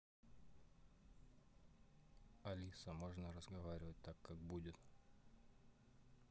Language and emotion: Russian, neutral